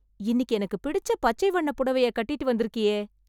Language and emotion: Tamil, happy